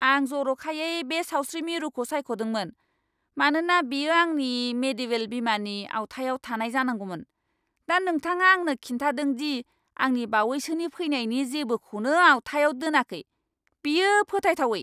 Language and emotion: Bodo, angry